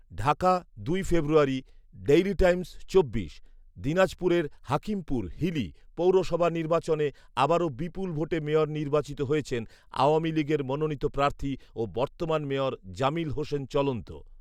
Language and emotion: Bengali, neutral